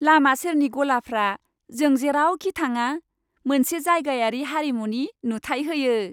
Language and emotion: Bodo, happy